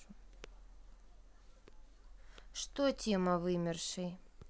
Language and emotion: Russian, neutral